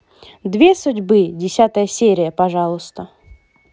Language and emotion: Russian, positive